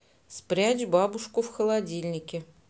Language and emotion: Russian, neutral